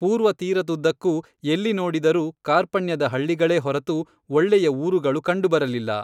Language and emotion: Kannada, neutral